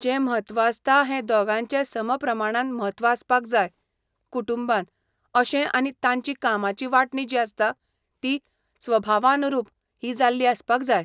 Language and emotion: Goan Konkani, neutral